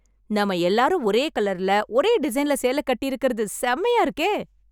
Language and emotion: Tamil, happy